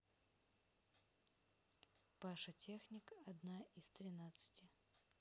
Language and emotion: Russian, neutral